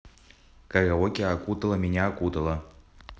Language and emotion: Russian, neutral